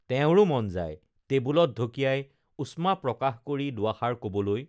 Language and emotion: Assamese, neutral